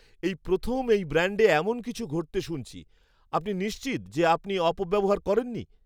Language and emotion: Bengali, surprised